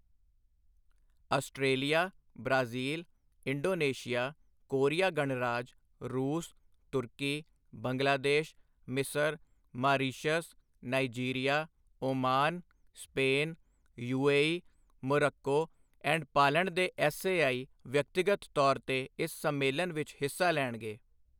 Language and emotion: Punjabi, neutral